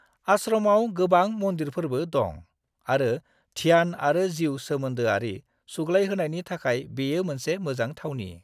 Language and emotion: Bodo, neutral